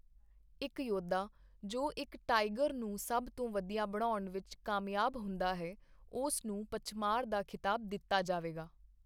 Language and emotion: Punjabi, neutral